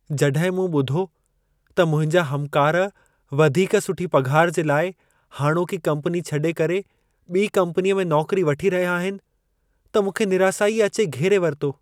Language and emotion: Sindhi, sad